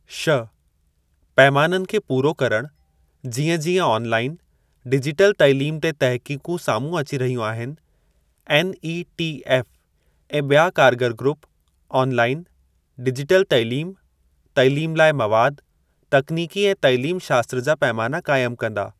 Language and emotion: Sindhi, neutral